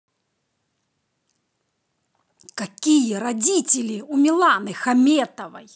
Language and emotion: Russian, angry